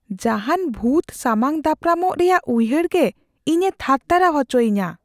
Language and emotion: Santali, fearful